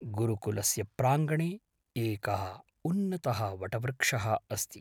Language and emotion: Sanskrit, neutral